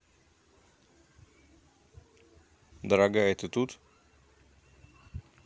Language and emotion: Russian, neutral